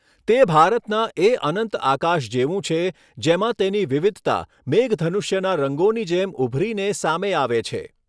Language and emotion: Gujarati, neutral